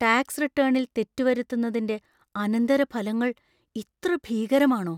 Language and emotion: Malayalam, fearful